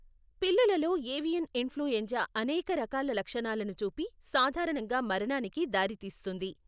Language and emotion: Telugu, neutral